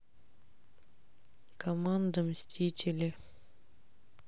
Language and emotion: Russian, sad